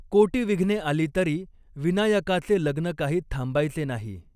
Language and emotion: Marathi, neutral